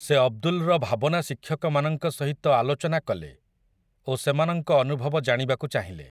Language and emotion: Odia, neutral